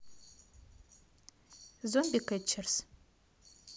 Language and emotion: Russian, neutral